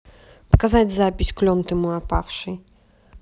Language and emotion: Russian, neutral